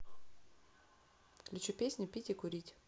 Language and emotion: Russian, neutral